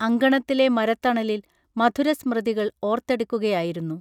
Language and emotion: Malayalam, neutral